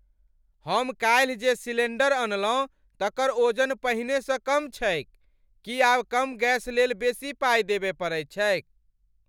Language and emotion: Maithili, angry